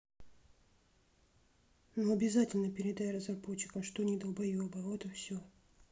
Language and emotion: Russian, neutral